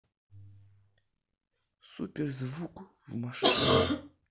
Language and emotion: Russian, neutral